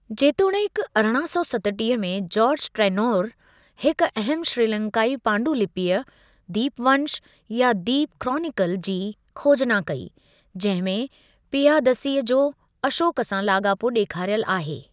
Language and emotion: Sindhi, neutral